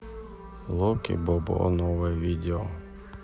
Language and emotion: Russian, sad